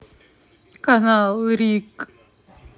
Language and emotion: Russian, neutral